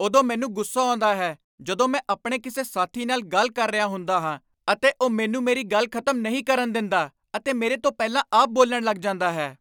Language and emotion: Punjabi, angry